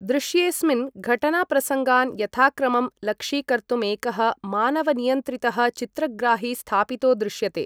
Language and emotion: Sanskrit, neutral